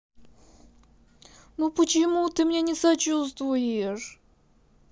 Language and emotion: Russian, sad